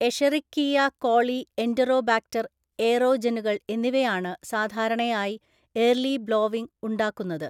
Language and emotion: Malayalam, neutral